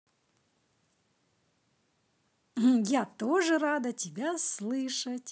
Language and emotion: Russian, positive